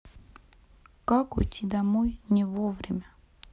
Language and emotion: Russian, sad